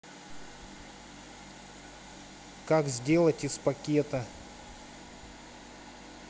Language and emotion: Russian, neutral